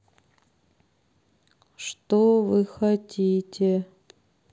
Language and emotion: Russian, sad